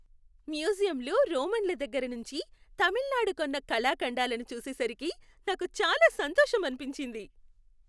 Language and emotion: Telugu, happy